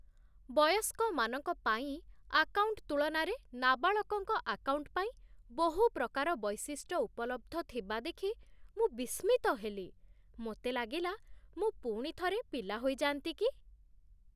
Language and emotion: Odia, surprised